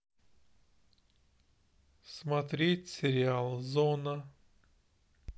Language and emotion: Russian, sad